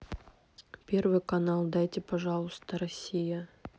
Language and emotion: Russian, neutral